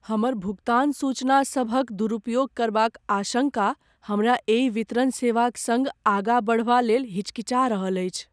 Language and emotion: Maithili, fearful